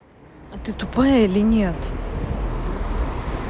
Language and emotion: Russian, angry